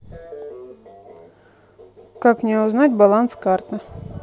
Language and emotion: Russian, neutral